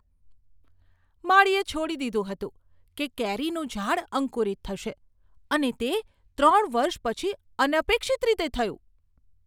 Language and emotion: Gujarati, surprised